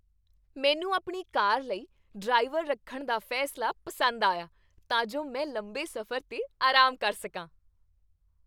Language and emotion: Punjabi, happy